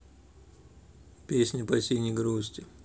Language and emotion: Russian, neutral